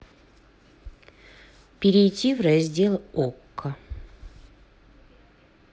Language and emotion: Russian, neutral